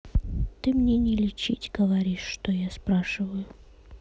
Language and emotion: Russian, sad